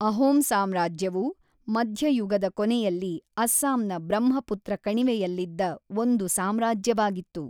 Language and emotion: Kannada, neutral